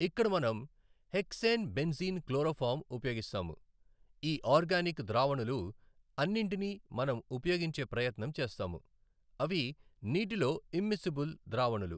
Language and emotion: Telugu, neutral